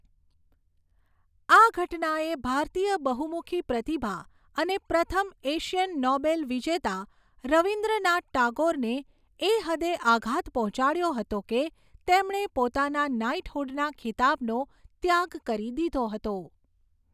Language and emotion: Gujarati, neutral